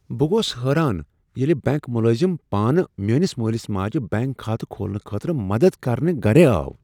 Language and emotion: Kashmiri, surprised